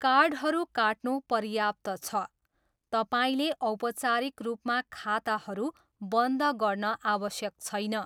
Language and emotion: Nepali, neutral